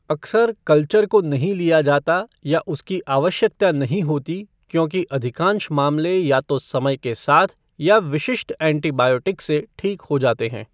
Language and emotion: Hindi, neutral